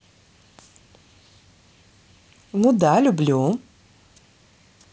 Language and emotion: Russian, positive